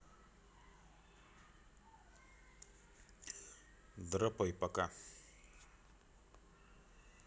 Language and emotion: Russian, neutral